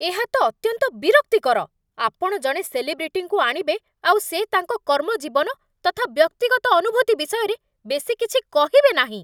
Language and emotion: Odia, angry